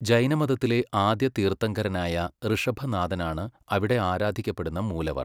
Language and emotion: Malayalam, neutral